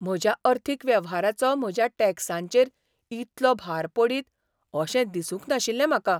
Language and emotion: Goan Konkani, surprised